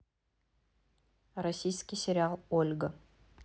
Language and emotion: Russian, neutral